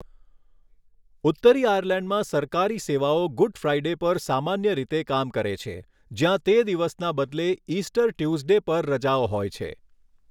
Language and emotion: Gujarati, neutral